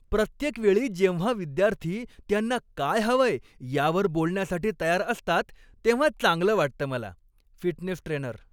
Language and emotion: Marathi, happy